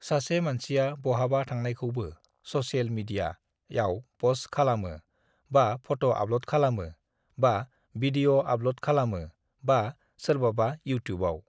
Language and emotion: Bodo, neutral